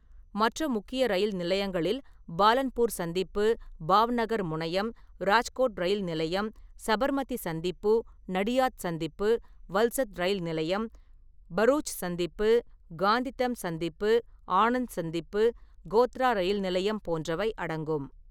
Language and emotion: Tamil, neutral